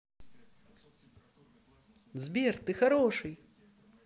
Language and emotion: Russian, positive